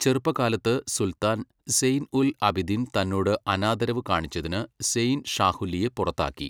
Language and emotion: Malayalam, neutral